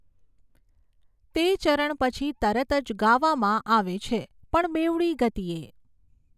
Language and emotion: Gujarati, neutral